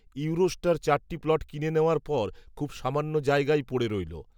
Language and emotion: Bengali, neutral